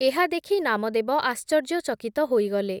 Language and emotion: Odia, neutral